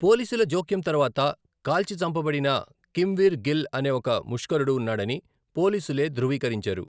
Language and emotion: Telugu, neutral